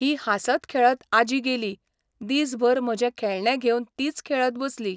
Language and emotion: Goan Konkani, neutral